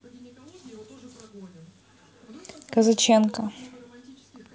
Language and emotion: Russian, neutral